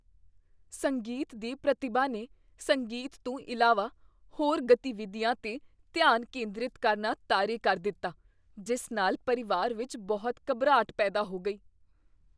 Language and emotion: Punjabi, fearful